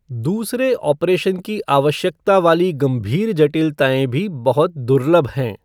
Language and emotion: Hindi, neutral